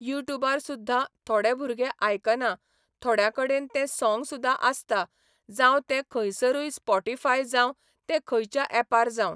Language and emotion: Goan Konkani, neutral